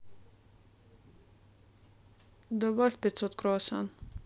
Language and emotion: Russian, neutral